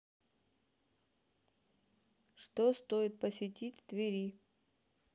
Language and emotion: Russian, neutral